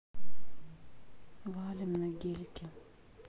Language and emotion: Russian, neutral